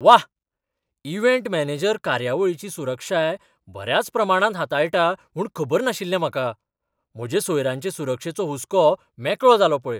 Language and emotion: Goan Konkani, surprised